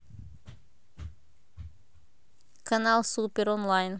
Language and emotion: Russian, neutral